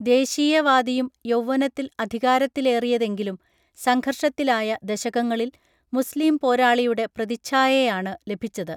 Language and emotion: Malayalam, neutral